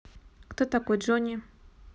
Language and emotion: Russian, neutral